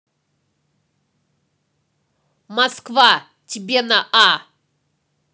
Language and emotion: Russian, angry